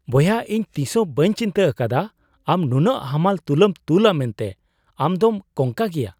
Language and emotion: Santali, surprised